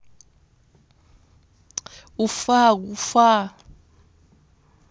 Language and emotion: Russian, neutral